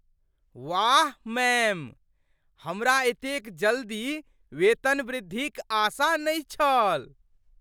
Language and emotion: Maithili, surprised